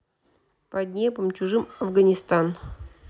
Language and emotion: Russian, neutral